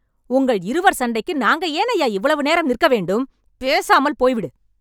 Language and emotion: Tamil, angry